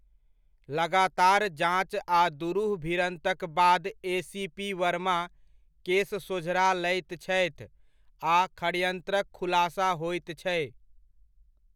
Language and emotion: Maithili, neutral